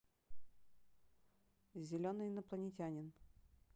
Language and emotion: Russian, neutral